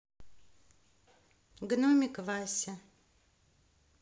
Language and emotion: Russian, neutral